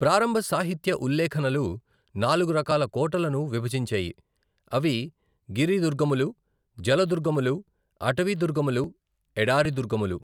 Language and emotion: Telugu, neutral